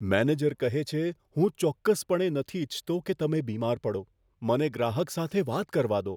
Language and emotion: Gujarati, fearful